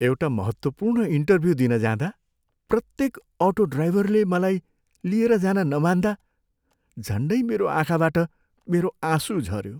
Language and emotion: Nepali, sad